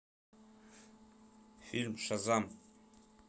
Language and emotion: Russian, neutral